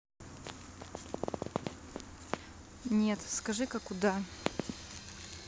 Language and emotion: Russian, neutral